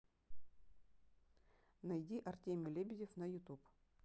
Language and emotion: Russian, neutral